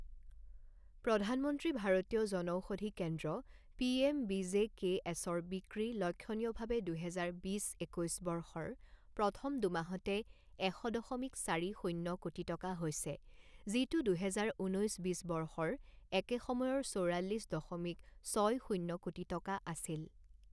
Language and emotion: Assamese, neutral